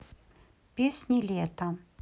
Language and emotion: Russian, neutral